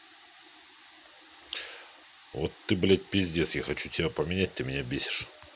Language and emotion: Russian, angry